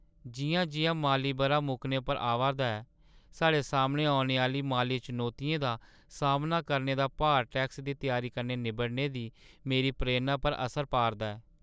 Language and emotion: Dogri, sad